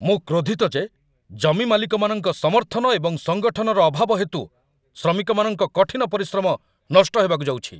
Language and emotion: Odia, angry